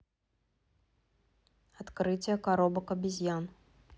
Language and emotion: Russian, neutral